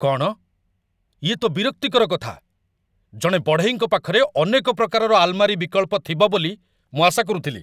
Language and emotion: Odia, angry